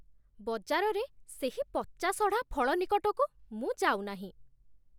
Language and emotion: Odia, disgusted